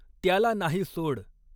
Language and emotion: Marathi, neutral